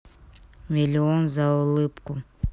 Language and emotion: Russian, neutral